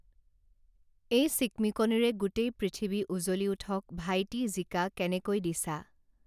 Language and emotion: Assamese, neutral